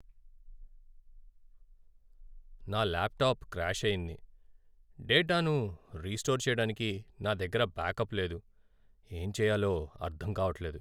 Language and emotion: Telugu, sad